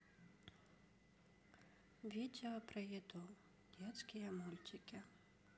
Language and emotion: Russian, sad